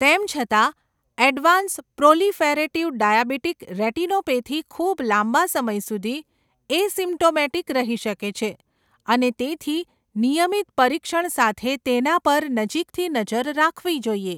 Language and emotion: Gujarati, neutral